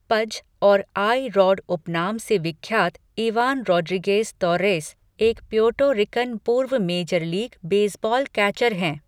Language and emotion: Hindi, neutral